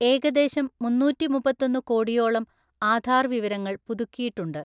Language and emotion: Malayalam, neutral